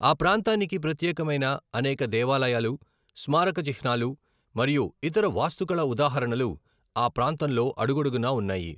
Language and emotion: Telugu, neutral